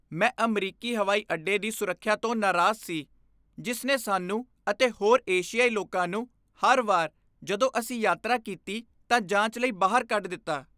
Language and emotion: Punjabi, disgusted